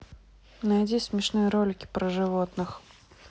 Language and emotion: Russian, neutral